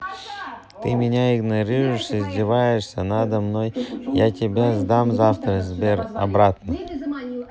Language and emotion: Russian, neutral